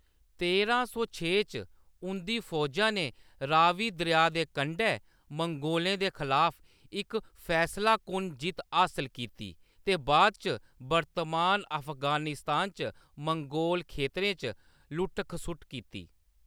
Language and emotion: Dogri, neutral